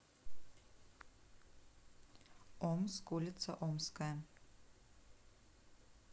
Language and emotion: Russian, neutral